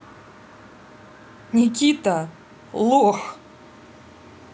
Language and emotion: Russian, angry